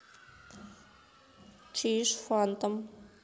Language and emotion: Russian, neutral